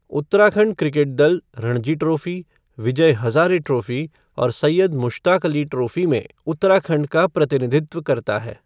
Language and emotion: Hindi, neutral